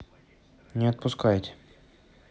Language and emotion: Russian, neutral